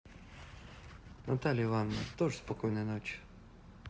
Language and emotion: Russian, neutral